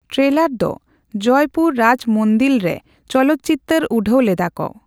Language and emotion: Santali, neutral